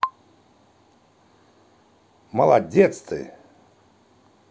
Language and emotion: Russian, positive